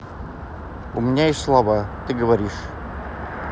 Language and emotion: Russian, neutral